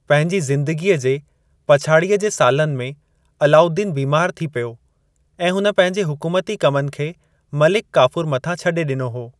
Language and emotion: Sindhi, neutral